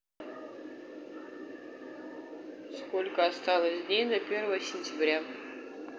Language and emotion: Russian, neutral